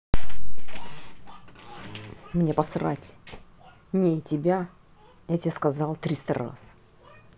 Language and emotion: Russian, angry